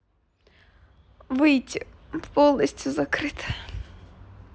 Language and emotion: Russian, sad